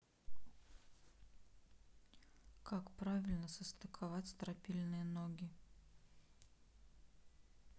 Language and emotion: Russian, neutral